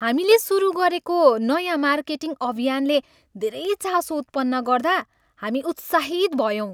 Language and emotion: Nepali, happy